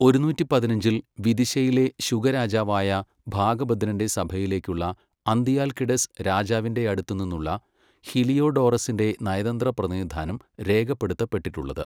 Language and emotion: Malayalam, neutral